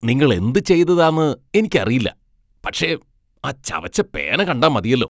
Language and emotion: Malayalam, disgusted